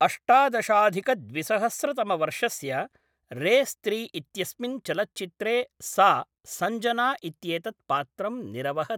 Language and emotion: Sanskrit, neutral